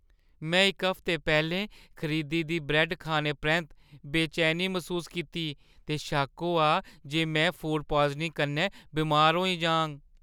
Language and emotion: Dogri, fearful